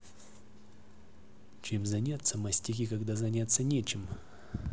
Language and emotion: Russian, neutral